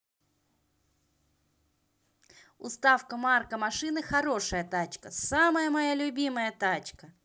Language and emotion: Russian, positive